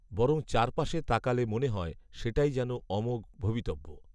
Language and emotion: Bengali, neutral